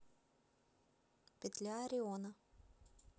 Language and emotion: Russian, neutral